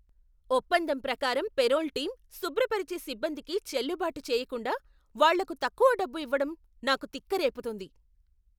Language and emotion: Telugu, angry